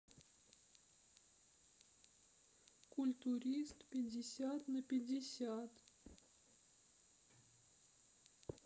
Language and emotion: Russian, sad